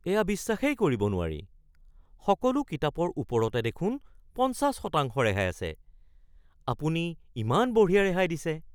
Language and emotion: Assamese, surprised